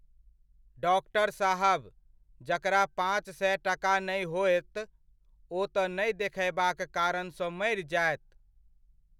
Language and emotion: Maithili, neutral